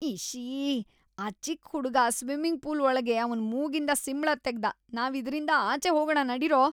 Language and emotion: Kannada, disgusted